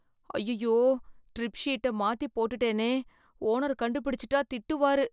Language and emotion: Tamil, fearful